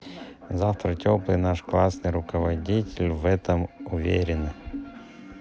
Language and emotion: Russian, neutral